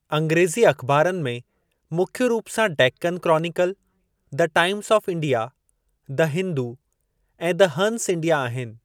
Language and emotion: Sindhi, neutral